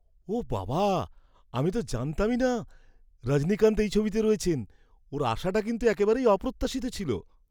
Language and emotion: Bengali, surprised